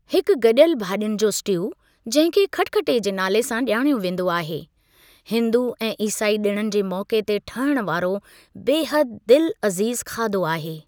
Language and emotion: Sindhi, neutral